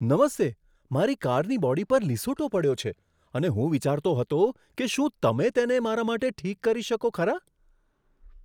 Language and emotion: Gujarati, surprised